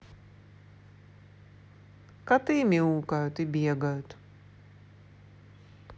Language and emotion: Russian, neutral